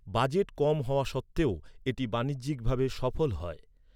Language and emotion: Bengali, neutral